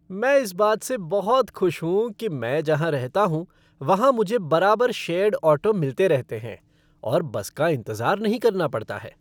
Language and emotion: Hindi, happy